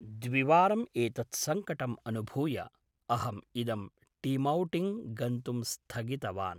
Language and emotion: Sanskrit, neutral